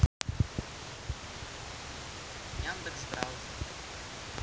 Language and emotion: Russian, neutral